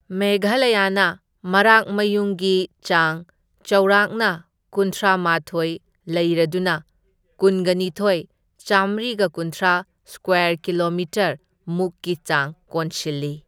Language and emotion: Manipuri, neutral